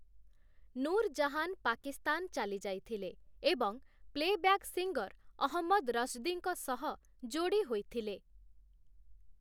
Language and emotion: Odia, neutral